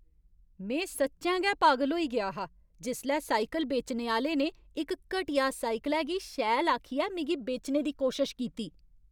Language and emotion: Dogri, angry